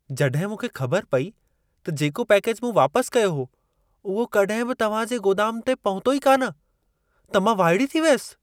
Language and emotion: Sindhi, surprised